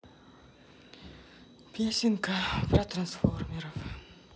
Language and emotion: Russian, sad